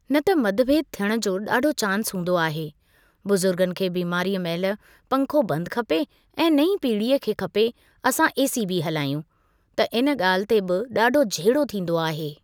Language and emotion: Sindhi, neutral